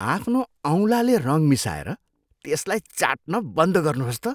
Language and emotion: Nepali, disgusted